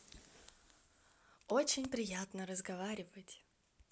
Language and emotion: Russian, positive